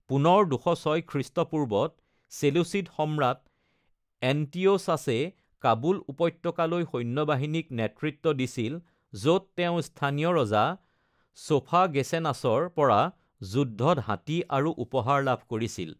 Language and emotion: Assamese, neutral